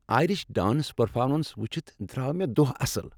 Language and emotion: Kashmiri, happy